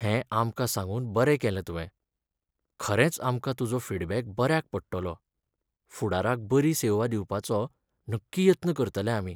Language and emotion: Goan Konkani, sad